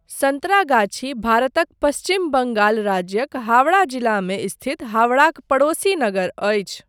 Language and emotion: Maithili, neutral